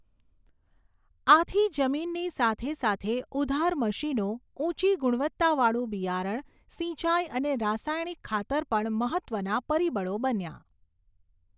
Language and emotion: Gujarati, neutral